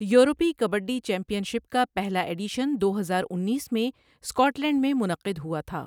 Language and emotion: Urdu, neutral